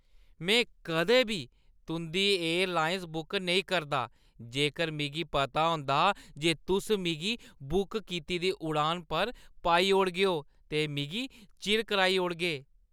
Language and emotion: Dogri, disgusted